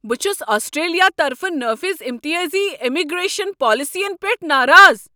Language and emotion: Kashmiri, angry